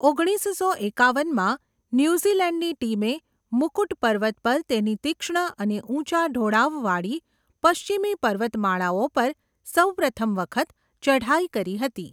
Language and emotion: Gujarati, neutral